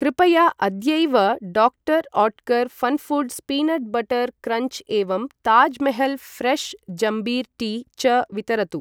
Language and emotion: Sanskrit, neutral